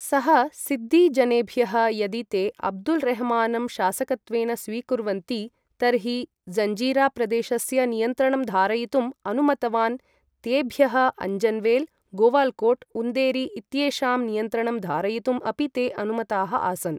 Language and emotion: Sanskrit, neutral